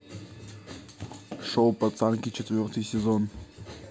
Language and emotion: Russian, neutral